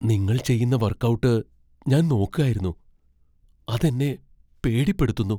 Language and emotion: Malayalam, fearful